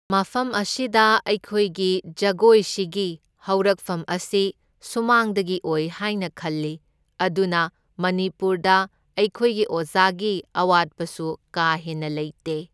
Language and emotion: Manipuri, neutral